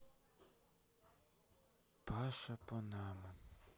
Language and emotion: Russian, sad